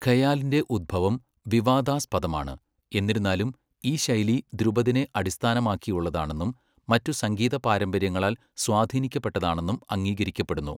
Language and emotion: Malayalam, neutral